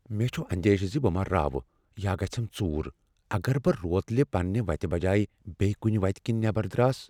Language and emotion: Kashmiri, fearful